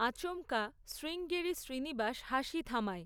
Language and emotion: Bengali, neutral